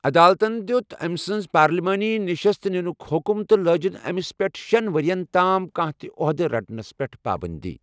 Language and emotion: Kashmiri, neutral